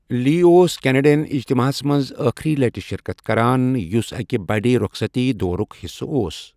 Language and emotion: Kashmiri, neutral